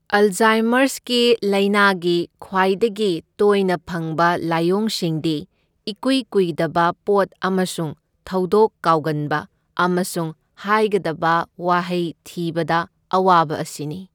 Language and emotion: Manipuri, neutral